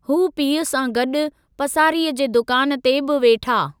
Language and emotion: Sindhi, neutral